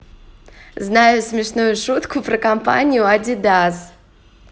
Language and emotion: Russian, positive